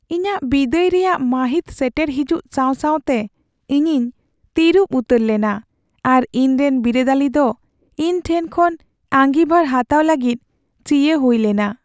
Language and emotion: Santali, sad